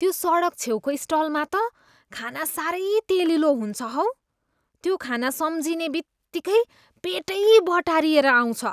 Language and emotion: Nepali, disgusted